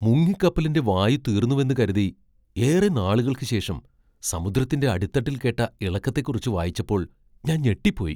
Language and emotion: Malayalam, surprised